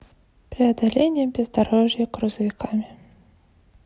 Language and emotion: Russian, neutral